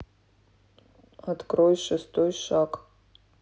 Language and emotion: Russian, neutral